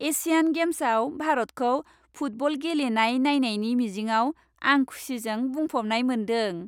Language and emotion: Bodo, happy